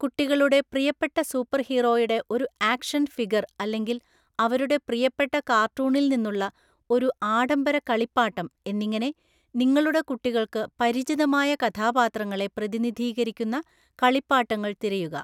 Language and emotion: Malayalam, neutral